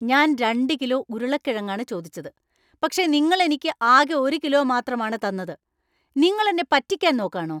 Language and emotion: Malayalam, angry